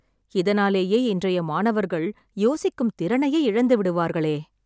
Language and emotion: Tamil, sad